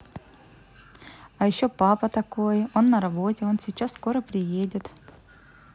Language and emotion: Russian, positive